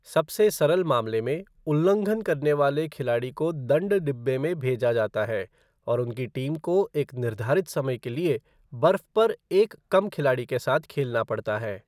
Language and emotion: Hindi, neutral